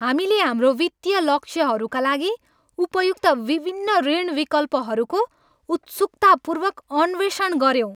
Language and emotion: Nepali, happy